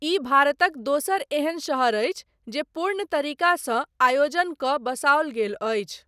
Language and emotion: Maithili, neutral